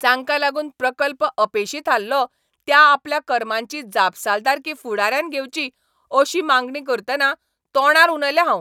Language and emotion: Goan Konkani, angry